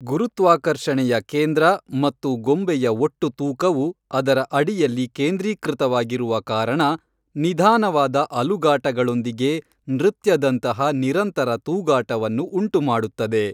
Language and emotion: Kannada, neutral